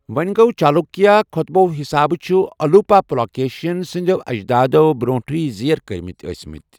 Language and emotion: Kashmiri, neutral